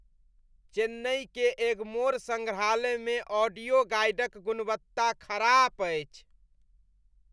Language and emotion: Maithili, disgusted